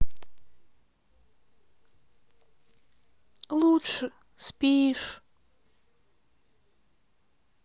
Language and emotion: Russian, sad